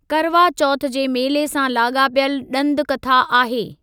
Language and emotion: Sindhi, neutral